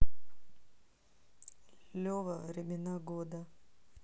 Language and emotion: Russian, neutral